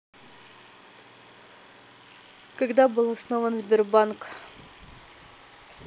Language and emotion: Russian, neutral